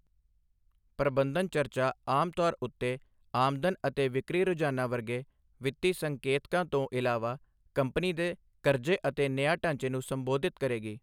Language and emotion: Punjabi, neutral